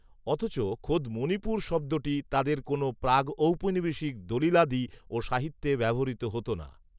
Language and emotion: Bengali, neutral